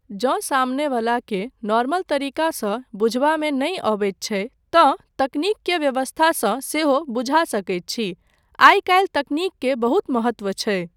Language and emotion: Maithili, neutral